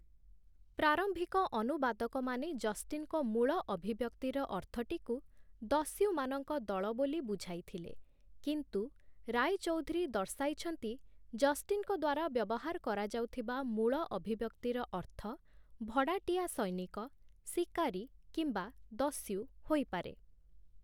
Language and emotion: Odia, neutral